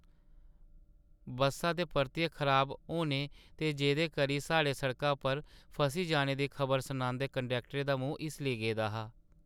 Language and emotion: Dogri, sad